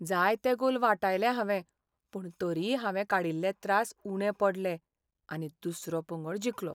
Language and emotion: Goan Konkani, sad